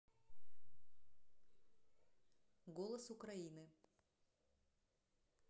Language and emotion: Russian, neutral